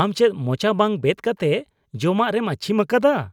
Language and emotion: Santali, disgusted